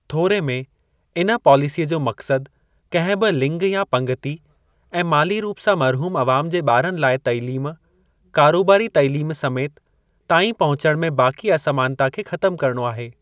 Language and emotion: Sindhi, neutral